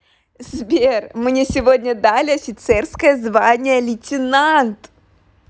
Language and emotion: Russian, positive